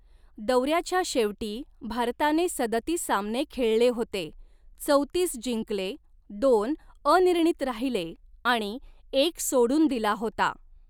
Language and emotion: Marathi, neutral